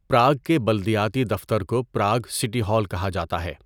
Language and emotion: Urdu, neutral